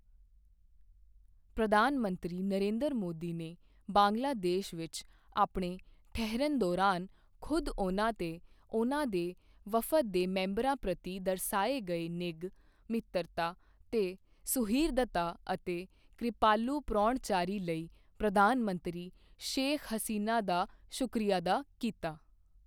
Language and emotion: Punjabi, neutral